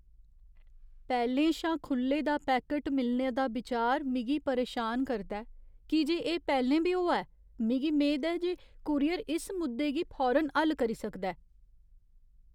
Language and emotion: Dogri, fearful